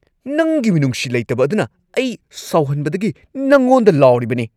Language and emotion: Manipuri, angry